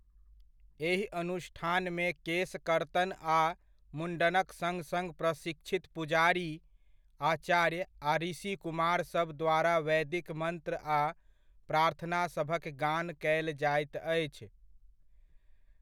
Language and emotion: Maithili, neutral